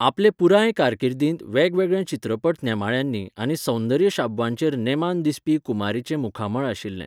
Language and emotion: Goan Konkani, neutral